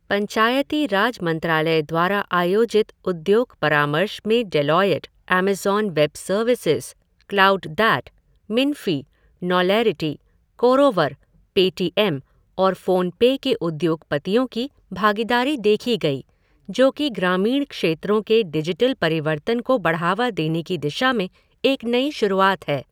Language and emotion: Hindi, neutral